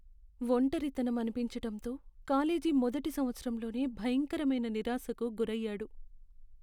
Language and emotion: Telugu, sad